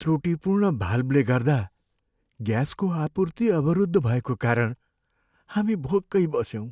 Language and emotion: Nepali, sad